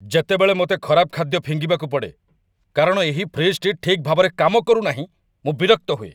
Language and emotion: Odia, angry